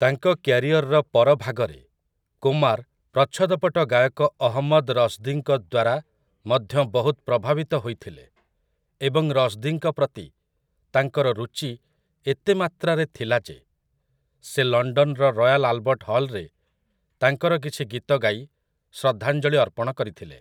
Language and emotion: Odia, neutral